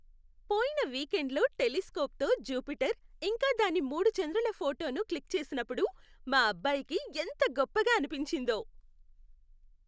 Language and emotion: Telugu, happy